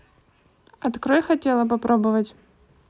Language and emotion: Russian, neutral